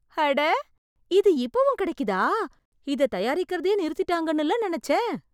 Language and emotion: Tamil, surprised